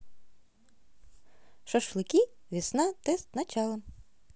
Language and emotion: Russian, positive